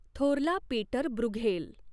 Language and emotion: Marathi, neutral